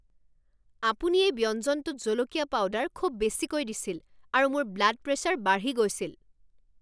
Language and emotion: Assamese, angry